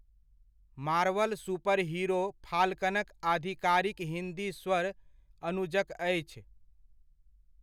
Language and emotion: Maithili, neutral